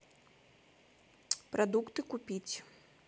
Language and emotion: Russian, neutral